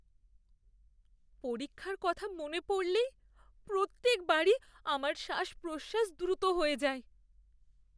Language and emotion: Bengali, fearful